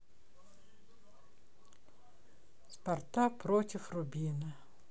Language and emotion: Russian, sad